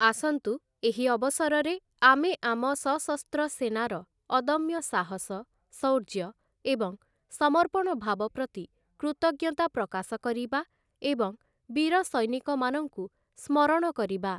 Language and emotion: Odia, neutral